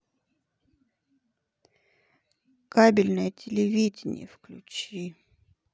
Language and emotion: Russian, sad